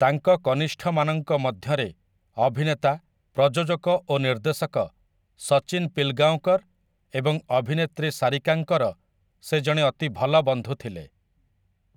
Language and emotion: Odia, neutral